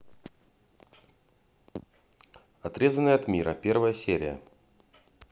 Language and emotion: Russian, neutral